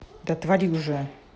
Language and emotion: Russian, angry